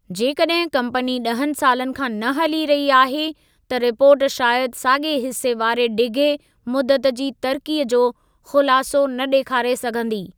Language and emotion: Sindhi, neutral